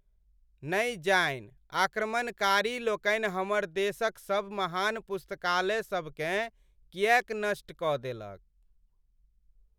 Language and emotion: Maithili, sad